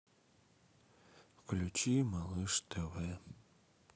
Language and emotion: Russian, sad